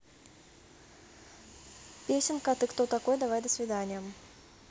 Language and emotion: Russian, neutral